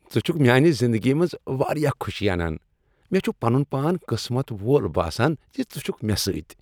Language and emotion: Kashmiri, happy